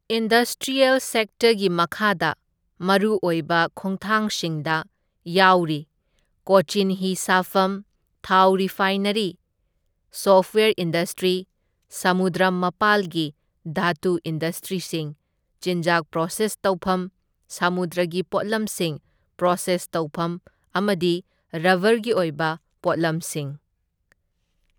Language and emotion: Manipuri, neutral